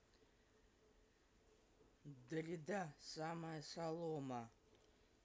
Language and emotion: Russian, neutral